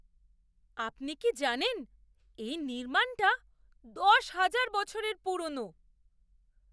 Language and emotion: Bengali, surprised